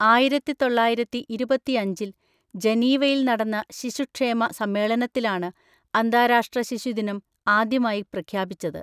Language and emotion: Malayalam, neutral